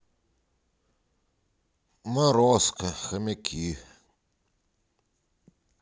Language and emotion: Russian, sad